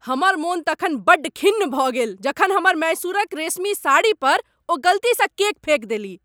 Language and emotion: Maithili, angry